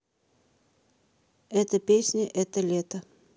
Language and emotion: Russian, neutral